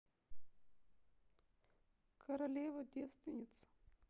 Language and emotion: Russian, neutral